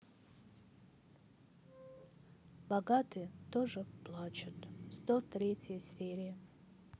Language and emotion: Russian, sad